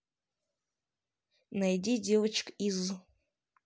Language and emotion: Russian, neutral